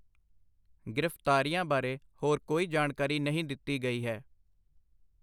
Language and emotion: Punjabi, neutral